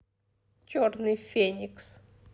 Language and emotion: Russian, neutral